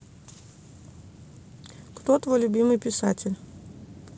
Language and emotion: Russian, neutral